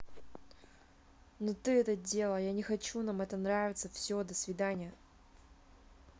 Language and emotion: Russian, angry